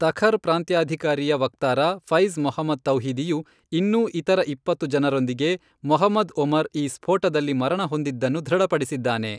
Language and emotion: Kannada, neutral